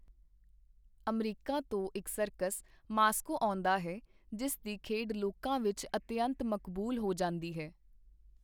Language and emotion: Punjabi, neutral